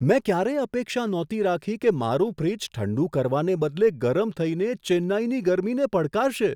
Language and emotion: Gujarati, surprised